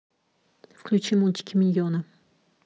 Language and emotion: Russian, neutral